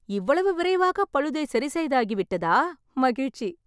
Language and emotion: Tamil, happy